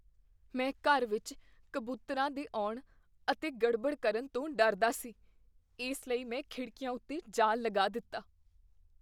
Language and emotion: Punjabi, fearful